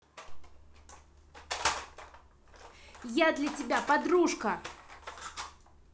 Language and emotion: Russian, angry